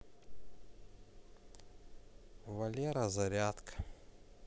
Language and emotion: Russian, neutral